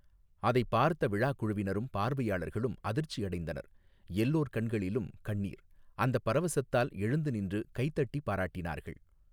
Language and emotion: Tamil, neutral